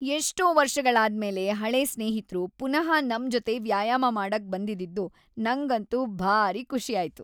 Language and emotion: Kannada, happy